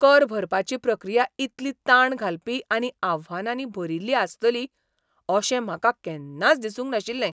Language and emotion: Goan Konkani, surprised